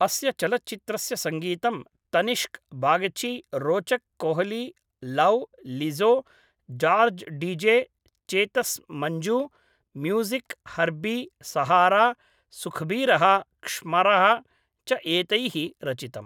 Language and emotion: Sanskrit, neutral